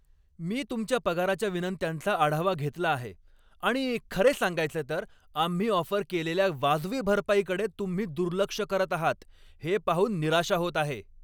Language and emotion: Marathi, angry